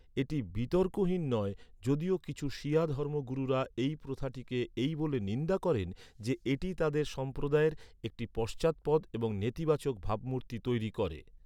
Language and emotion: Bengali, neutral